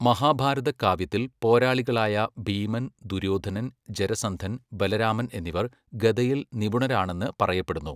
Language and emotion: Malayalam, neutral